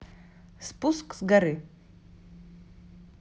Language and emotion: Russian, neutral